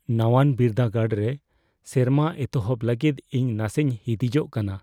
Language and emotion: Santali, fearful